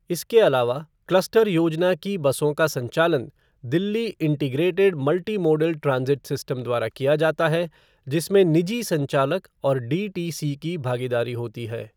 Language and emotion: Hindi, neutral